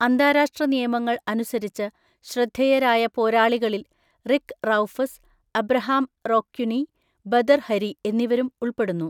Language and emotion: Malayalam, neutral